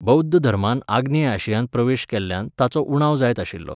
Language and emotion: Goan Konkani, neutral